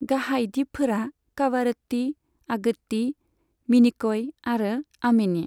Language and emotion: Bodo, neutral